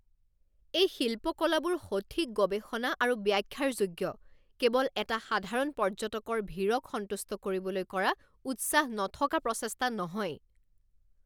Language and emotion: Assamese, angry